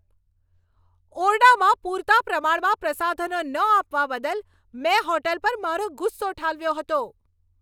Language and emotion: Gujarati, angry